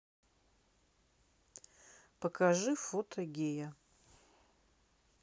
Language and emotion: Russian, neutral